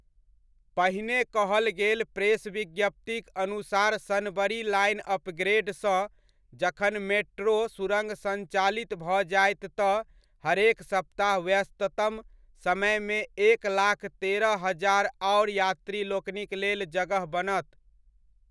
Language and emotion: Maithili, neutral